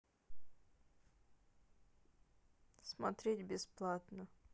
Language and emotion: Russian, sad